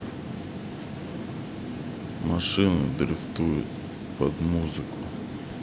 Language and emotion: Russian, neutral